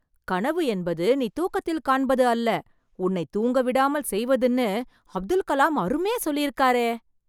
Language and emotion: Tamil, surprised